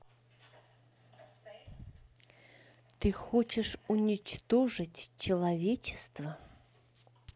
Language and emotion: Russian, neutral